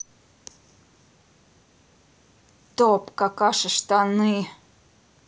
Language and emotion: Russian, neutral